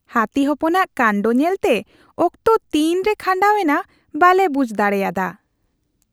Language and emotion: Santali, happy